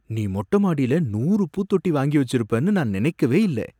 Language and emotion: Tamil, surprised